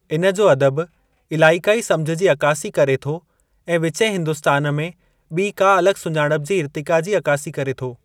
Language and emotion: Sindhi, neutral